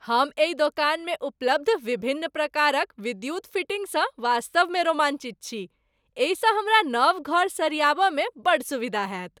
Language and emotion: Maithili, happy